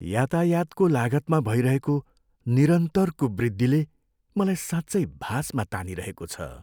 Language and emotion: Nepali, sad